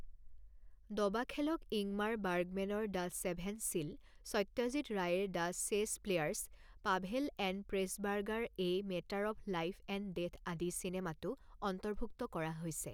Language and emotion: Assamese, neutral